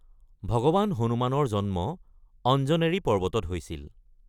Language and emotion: Assamese, neutral